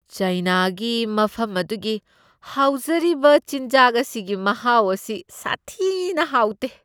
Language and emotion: Manipuri, disgusted